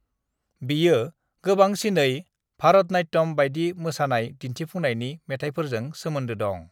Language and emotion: Bodo, neutral